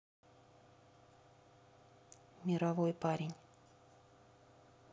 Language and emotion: Russian, neutral